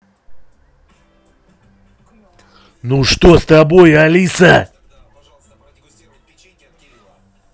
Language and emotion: Russian, angry